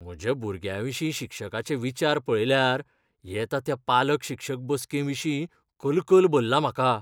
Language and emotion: Goan Konkani, fearful